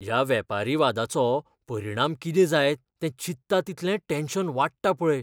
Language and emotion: Goan Konkani, fearful